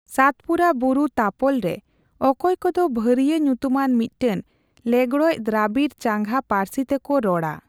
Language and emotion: Santali, neutral